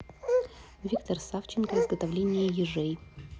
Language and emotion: Russian, neutral